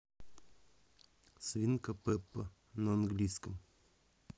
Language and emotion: Russian, neutral